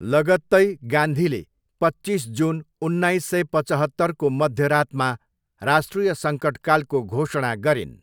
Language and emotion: Nepali, neutral